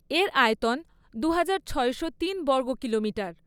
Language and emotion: Bengali, neutral